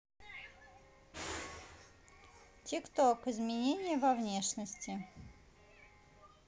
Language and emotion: Russian, neutral